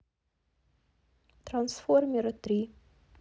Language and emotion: Russian, neutral